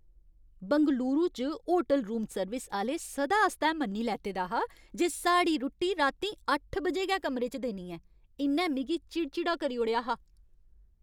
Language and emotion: Dogri, angry